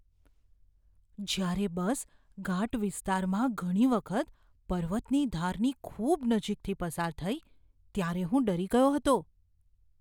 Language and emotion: Gujarati, fearful